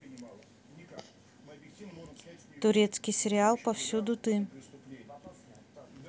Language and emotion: Russian, neutral